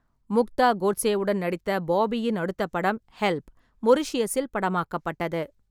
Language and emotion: Tamil, neutral